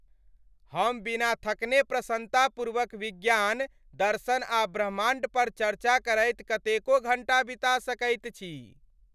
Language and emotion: Maithili, happy